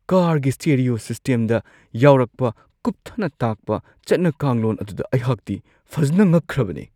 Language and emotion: Manipuri, surprised